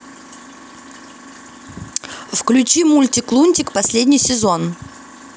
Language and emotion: Russian, neutral